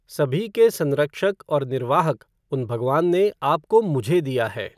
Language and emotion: Hindi, neutral